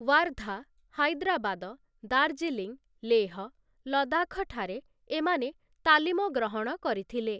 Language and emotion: Odia, neutral